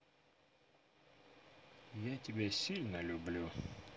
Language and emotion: Russian, positive